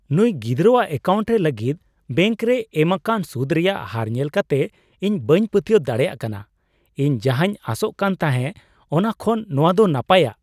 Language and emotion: Santali, surprised